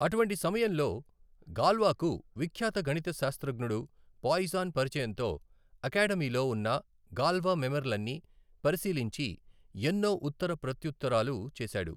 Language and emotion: Telugu, neutral